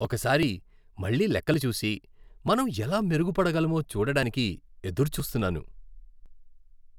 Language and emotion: Telugu, happy